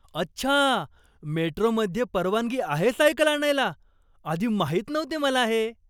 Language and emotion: Marathi, surprised